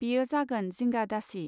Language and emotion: Bodo, neutral